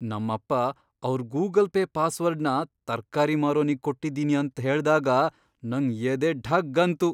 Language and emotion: Kannada, surprised